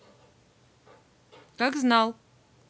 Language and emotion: Russian, neutral